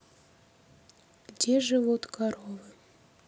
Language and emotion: Russian, sad